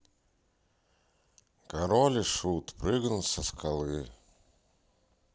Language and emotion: Russian, sad